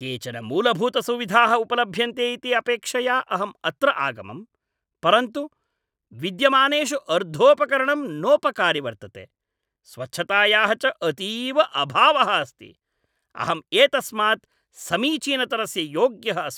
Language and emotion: Sanskrit, angry